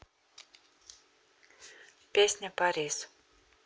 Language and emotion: Russian, neutral